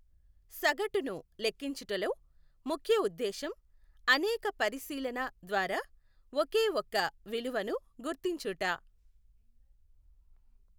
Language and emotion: Telugu, neutral